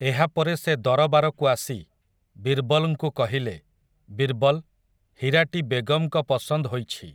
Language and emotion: Odia, neutral